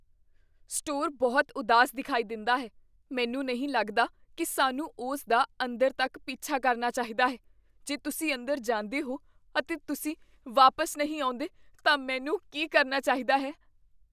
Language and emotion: Punjabi, fearful